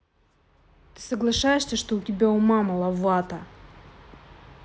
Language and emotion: Russian, angry